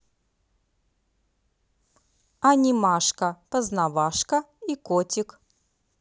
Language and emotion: Russian, positive